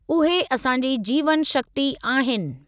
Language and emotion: Sindhi, neutral